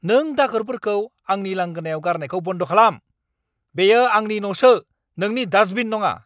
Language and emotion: Bodo, angry